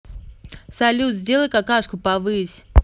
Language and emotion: Russian, neutral